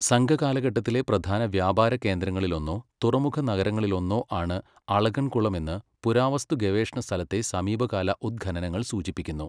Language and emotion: Malayalam, neutral